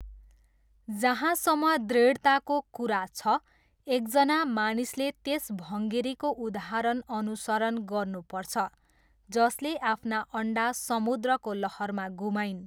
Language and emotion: Nepali, neutral